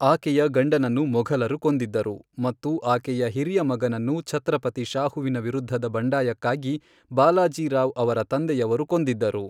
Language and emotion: Kannada, neutral